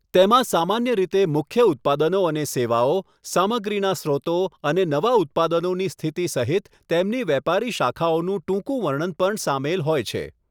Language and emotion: Gujarati, neutral